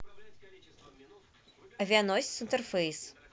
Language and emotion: Russian, neutral